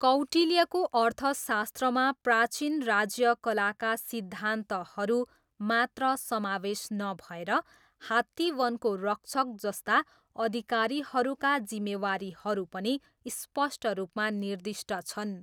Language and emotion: Nepali, neutral